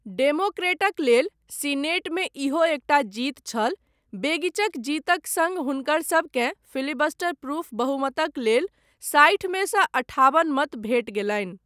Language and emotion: Maithili, neutral